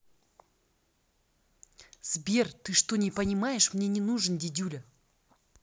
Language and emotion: Russian, angry